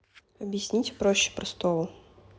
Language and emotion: Russian, neutral